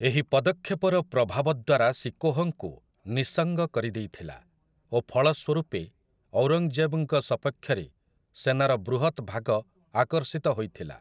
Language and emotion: Odia, neutral